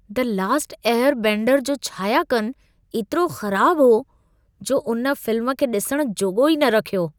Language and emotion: Sindhi, disgusted